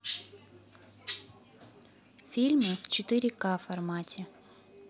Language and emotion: Russian, neutral